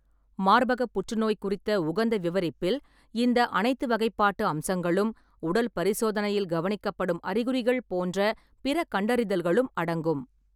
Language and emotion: Tamil, neutral